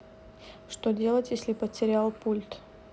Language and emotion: Russian, neutral